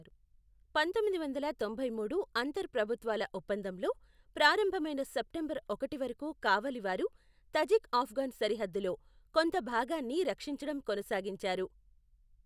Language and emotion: Telugu, neutral